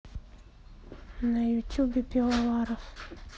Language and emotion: Russian, sad